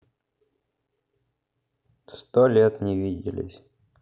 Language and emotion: Russian, sad